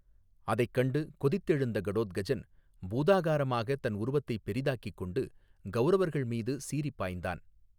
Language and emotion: Tamil, neutral